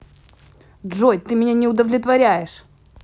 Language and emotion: Russian, angry